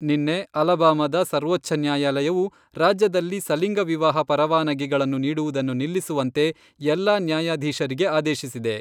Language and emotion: Kannada, neutral